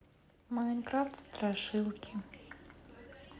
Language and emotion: Russian, sad